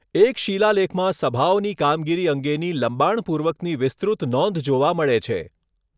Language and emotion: Gujarati, neutral